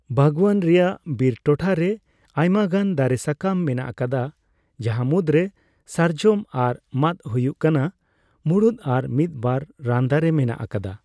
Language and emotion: Santali, neutral